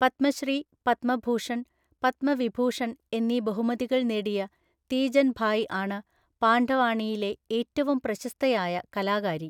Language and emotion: Malayalam, neutral